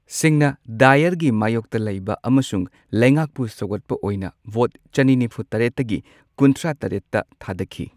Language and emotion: Manipuri, neutral